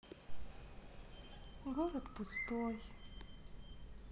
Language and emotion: Russian, sad